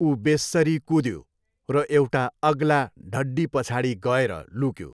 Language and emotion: Nepali, neutral